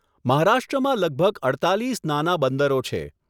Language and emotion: Gujarati, neutral